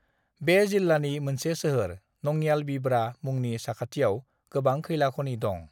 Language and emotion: Bodo, neutral